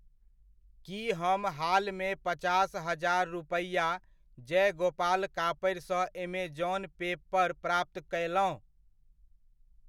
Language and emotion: Maithili, neutral